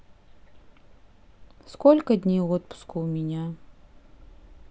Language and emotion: Russian, neutral